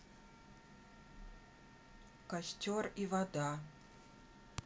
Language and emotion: Russian, neutral